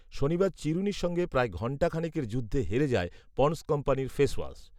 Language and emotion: Bengali, neutral